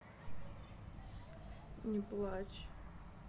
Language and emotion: Russian, sad